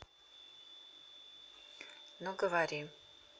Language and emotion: Russian, neutral